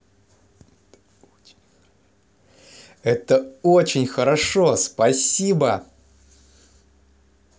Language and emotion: Russian, positive